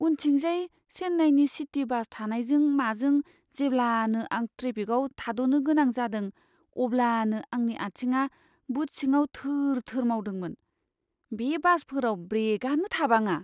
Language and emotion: Bodo, fearful